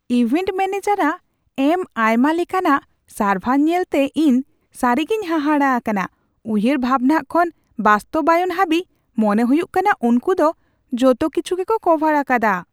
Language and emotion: Santali, surprised